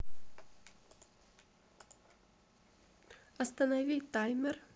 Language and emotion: Russian, neutral